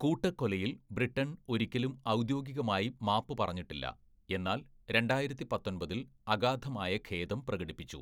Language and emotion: Malayalam, neutral